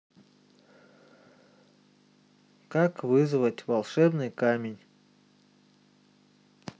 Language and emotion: Russian, neutral